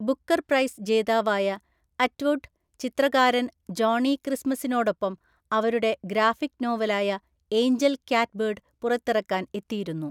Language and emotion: Malayalam, neutral